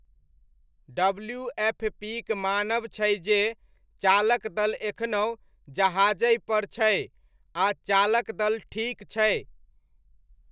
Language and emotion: Maithili, neutral